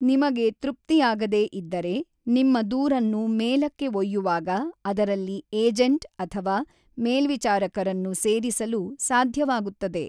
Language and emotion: Kannada, neutral